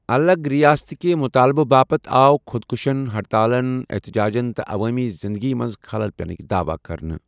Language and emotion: Kashmiri, neutral